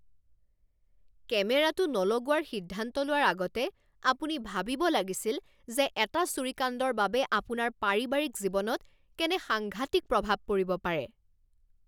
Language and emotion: Assamese, angry